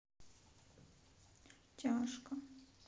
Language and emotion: Russian, sad